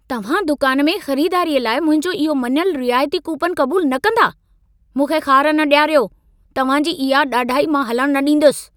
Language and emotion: Sindhi, angry